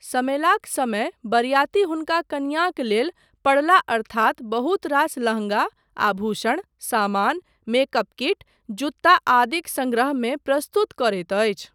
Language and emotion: Maithili, neutral